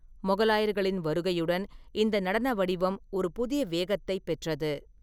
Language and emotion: Tamil, neutral